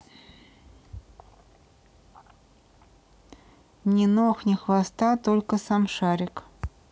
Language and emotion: Russian, neutral